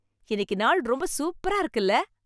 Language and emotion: Tamil, happy